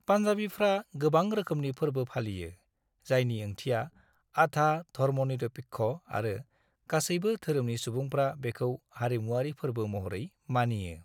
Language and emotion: Bodo, neutral